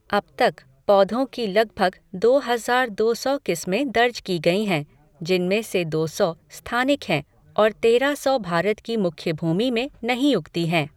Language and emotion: Hindi, neutral